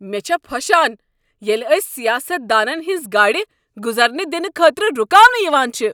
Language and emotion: Kashmiri, angry